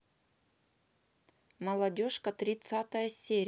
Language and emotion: Russian, neutral